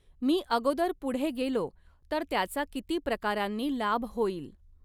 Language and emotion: Marathi, neutral